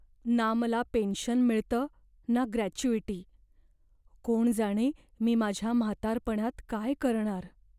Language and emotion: Marathi, fearful